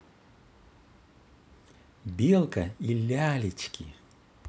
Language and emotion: Russian, positive